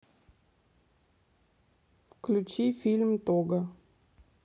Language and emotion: Russian, neutral